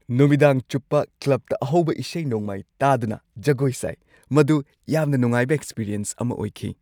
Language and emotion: Manipuri, happy